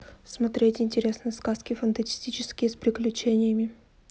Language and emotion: Russian, neutral